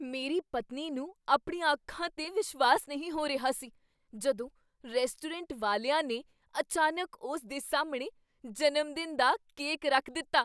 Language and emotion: Punjabi, surprised